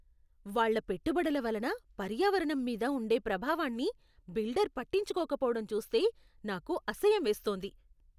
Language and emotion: Telugu, disgusted